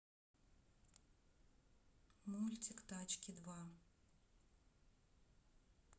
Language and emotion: Russian, neutral